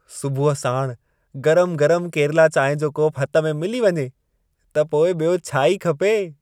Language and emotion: Sindhi, happy